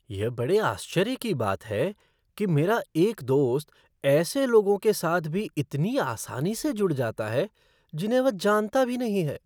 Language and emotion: Hindi, surprised